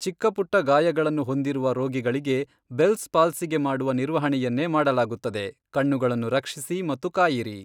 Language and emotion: Kannada, neutral